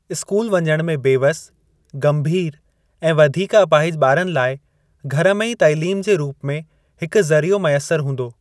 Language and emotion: Sindhi, neutral